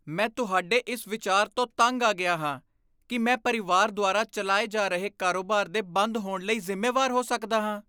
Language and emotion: Punjabi, disgusted